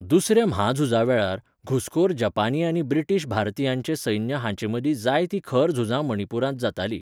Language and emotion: Goan Konkani, neutral